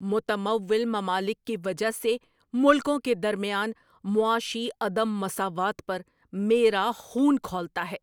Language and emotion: Urdu, angry